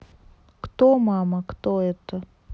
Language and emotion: Russian, neutral